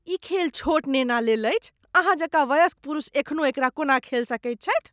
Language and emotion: Maithili, disgusted